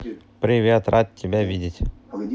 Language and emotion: Russian, positive